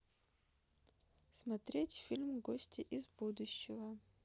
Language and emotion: Russian, neutral